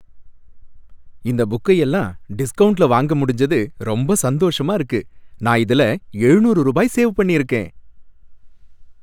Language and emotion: Tamil, happy